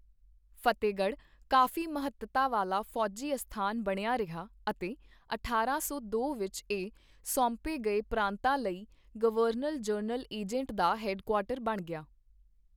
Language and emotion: Punjabi, neutral